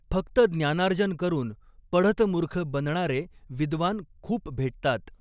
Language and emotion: Marathi, neutral